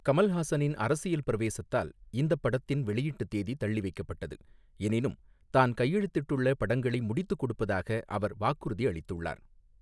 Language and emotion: Tamil, neutral